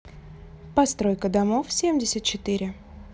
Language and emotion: Russian, neutral